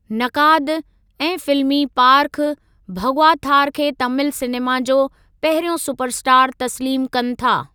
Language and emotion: Sindhi, neutral